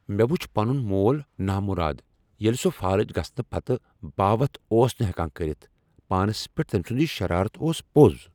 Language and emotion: Kashmiri, angry